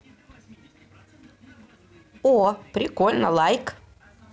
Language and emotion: Russian, positive